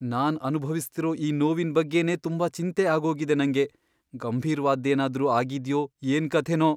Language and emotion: Kannada, fearful